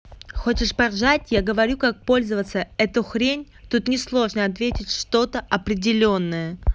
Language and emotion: Russian, angry